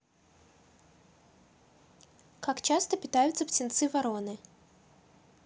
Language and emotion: Russian, neutral